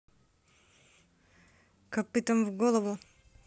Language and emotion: Russian, neutral